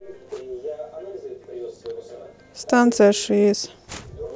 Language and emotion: Russian, neutral